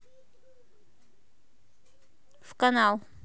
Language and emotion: Russian, neutral